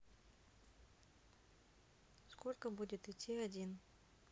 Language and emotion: Russian, neutral